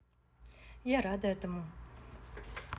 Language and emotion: Russian, positive